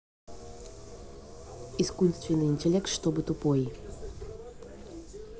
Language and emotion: Russian, neutral